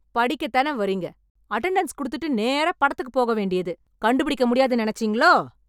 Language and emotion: Tamil, angry